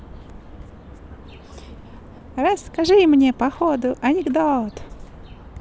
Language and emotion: Russian, positive